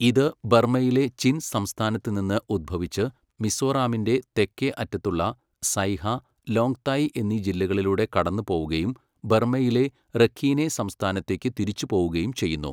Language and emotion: Malayalam, neutral